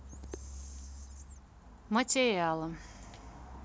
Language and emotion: Russian, neutral